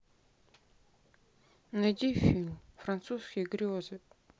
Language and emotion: Russian, sad